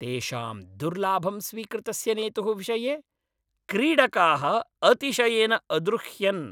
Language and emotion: Sanskrit, angry